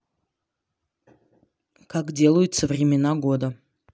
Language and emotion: Russian, neutral